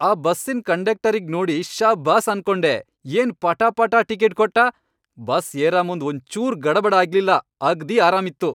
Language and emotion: Kannada, happy